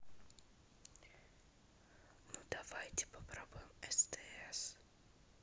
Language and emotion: Russian, neutral